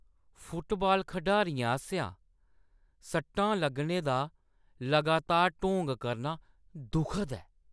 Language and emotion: Dogri, disgusted